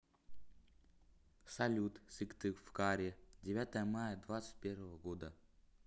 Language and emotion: Russian, neutral